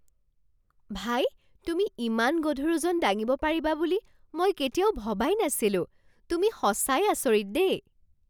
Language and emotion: Assamese, surprised